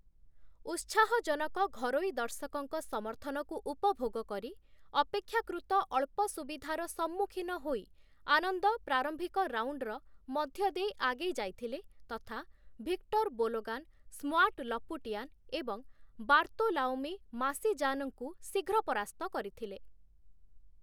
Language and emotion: Odia, neutral